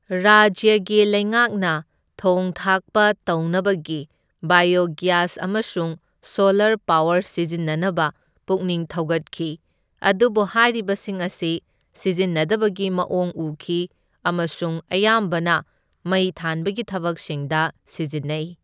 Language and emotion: Manipuri, neutral